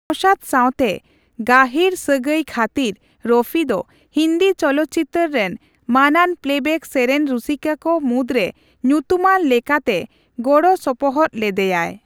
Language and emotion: Santali, neutral